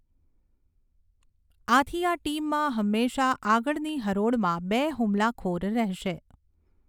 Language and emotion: Gujarati, neutral